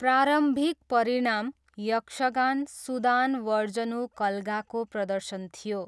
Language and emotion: Nepali, neutral